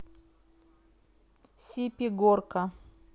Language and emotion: Russian, neutral